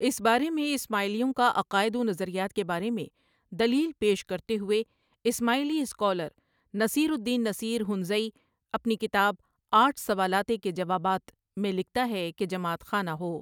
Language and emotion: Urdu, neutral